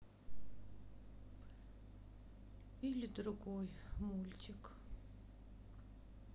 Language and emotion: Russian, sad